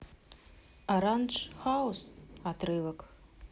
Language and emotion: Russian, neutral